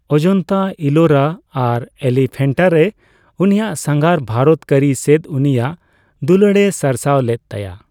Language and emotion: Santali, neutral